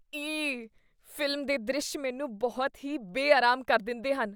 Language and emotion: Punjabi, disgusted